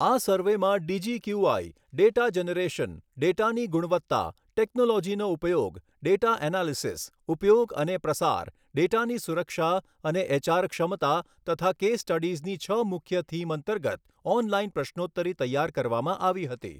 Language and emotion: Gujarati, neutral